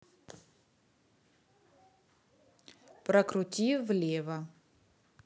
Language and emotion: Russian, neutral